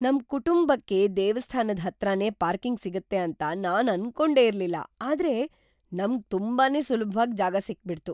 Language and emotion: Kannada, surprised